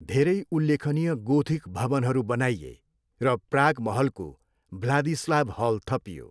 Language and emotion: Nepali, neutral